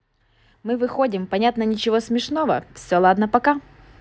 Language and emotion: Russian, positive